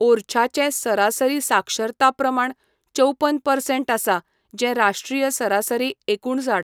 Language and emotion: Goan Konkani, neutral